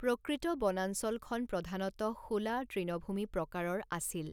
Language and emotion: Assamese, neutral